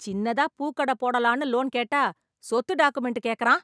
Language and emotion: Tamil, angry